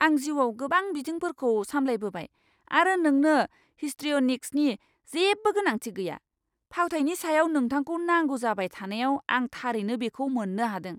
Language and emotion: Bodo, angry